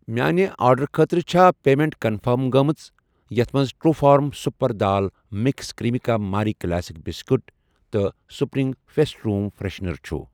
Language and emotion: Kashmiri, neutral